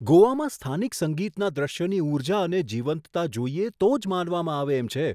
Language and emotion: Gujarati, surprised